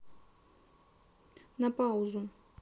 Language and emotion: Russian, neutral